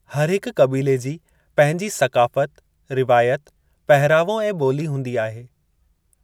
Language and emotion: Sindhi, neutral